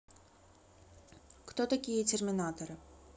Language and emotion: Russian, neutral